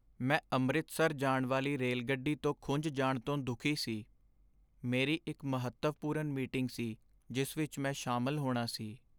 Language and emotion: Punjabi, sad